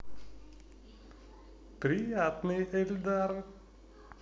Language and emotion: Russian, positive